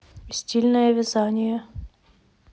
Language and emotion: Russian, neutral